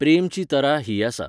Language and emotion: Goan Konkani, neutral